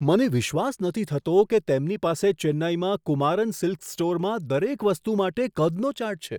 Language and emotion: Gujarati, surprised